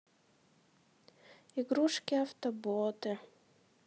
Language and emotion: Russian, sad